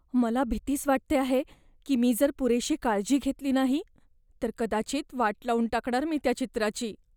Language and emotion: Marathi, fearful